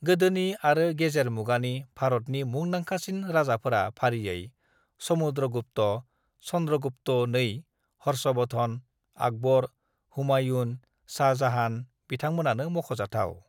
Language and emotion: Bodo, neutral